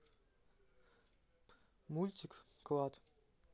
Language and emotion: Russian, neutral